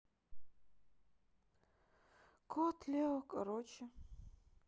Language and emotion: Russian, sad